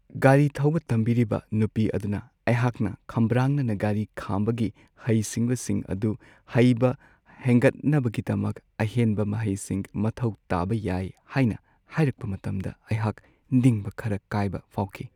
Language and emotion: Manipuri, sad